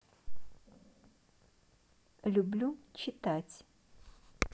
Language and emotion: Russian, neutral